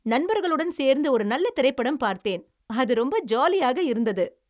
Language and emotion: Tamil, happy